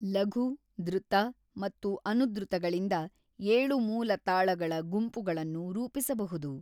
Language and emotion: Kannada, neutral